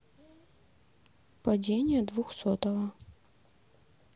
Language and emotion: Russian, neutral